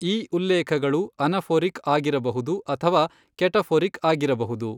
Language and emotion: Kannada, neutral